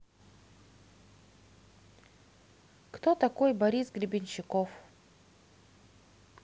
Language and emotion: Russian, positive